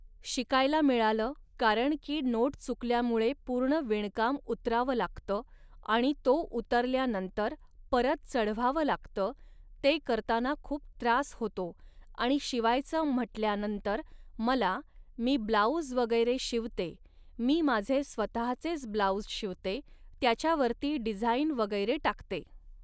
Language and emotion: Marathi, neutral